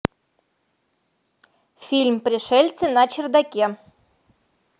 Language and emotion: Russian, neutral